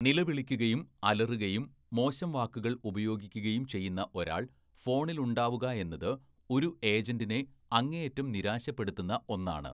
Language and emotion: Malayalam, neutral